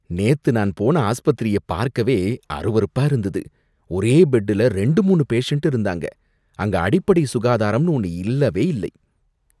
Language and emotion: Tamil, disgusted